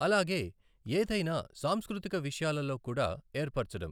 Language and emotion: Telugu, neutral